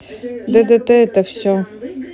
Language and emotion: Russian, neutral